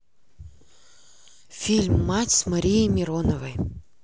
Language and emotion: Russian, neutral